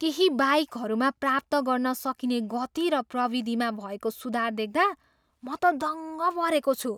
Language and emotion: Nepali, surprised